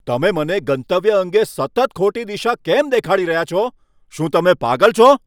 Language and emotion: Gujarati, angry